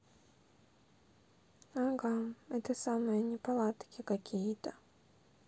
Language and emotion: Russian, sad